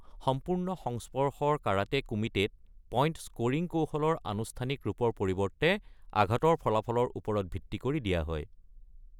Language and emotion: Assamese, neutral